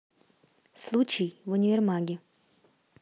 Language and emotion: Russian, neutral